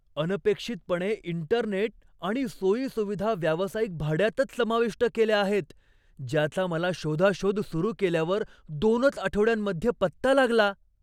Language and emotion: Marathi, surprised